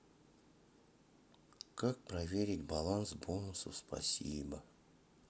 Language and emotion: Russian, sad